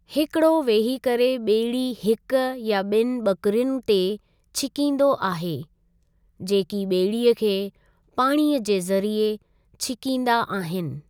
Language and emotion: Sindhi, neutral